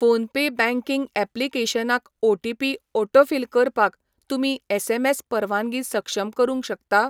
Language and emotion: Goan Konkani, neutral